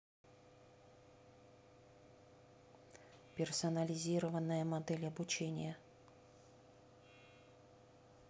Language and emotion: Russian, neutral